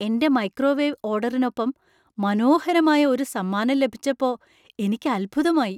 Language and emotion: Malayalam, surprised